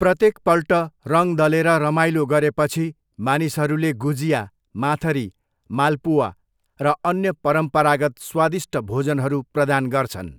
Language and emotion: Nepali, neutral